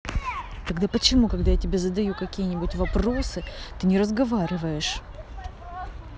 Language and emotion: Russian, angry